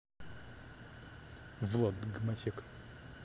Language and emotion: Russian, angry